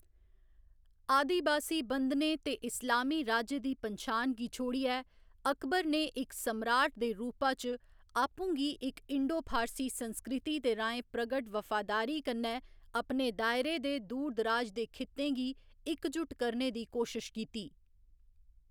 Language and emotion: Dogri, neutral